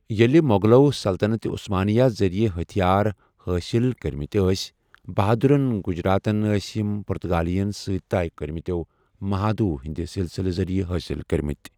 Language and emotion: Kashmiri, neutral